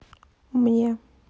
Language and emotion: Russian, neutral